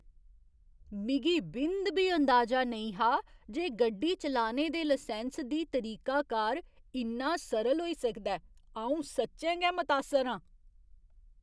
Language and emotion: Dogri, surprised